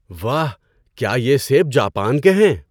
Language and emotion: Urdu, surprised